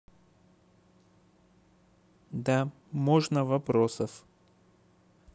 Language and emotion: Russian, neutral